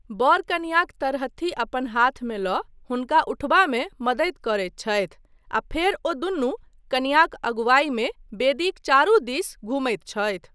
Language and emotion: Maithili, neutral